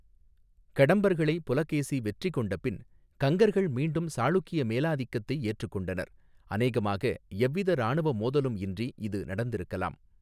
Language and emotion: Tamil, neutral